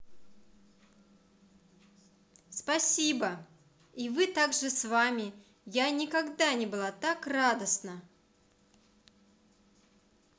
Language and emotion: Russian, positive